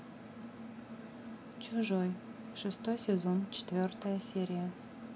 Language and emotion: Russian, neutral